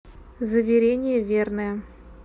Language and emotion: Russian, neutral